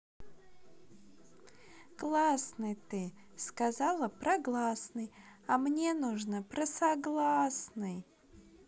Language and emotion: Russian, positive